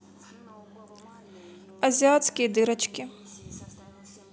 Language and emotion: Russian, neutral